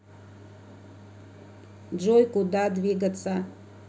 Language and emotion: Russian, neutral